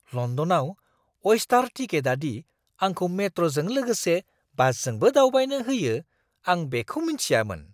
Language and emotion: Bodo, surprised